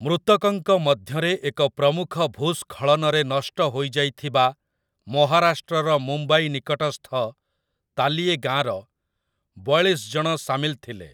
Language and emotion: Odia, neutral